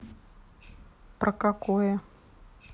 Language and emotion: Russian, neutral